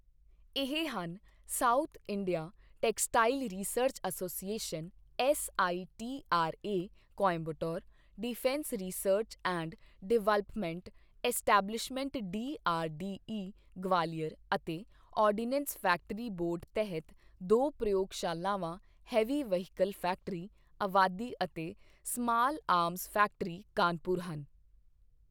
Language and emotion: Punjabi, neutral